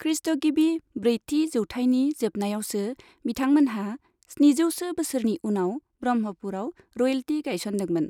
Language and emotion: Bodo, neutral